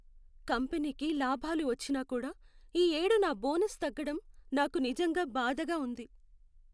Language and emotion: Telugu, sad